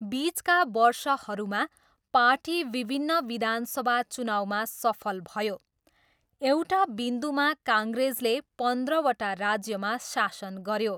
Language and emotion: Nepali, neutral